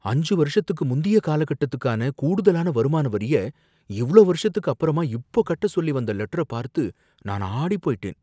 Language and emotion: Tamil, fearful